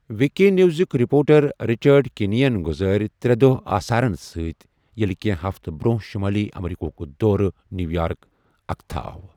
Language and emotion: Kashmiri, neutral